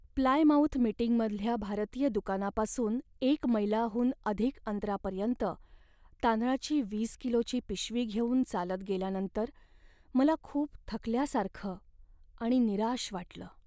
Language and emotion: Marathi, sad